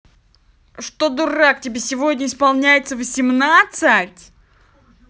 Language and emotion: Russian, angry